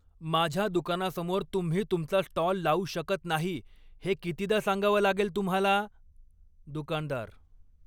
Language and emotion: Marathi, angry